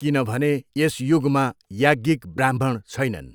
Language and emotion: Nepali, neutral